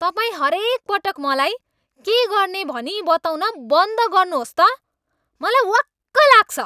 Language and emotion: Nepali, angry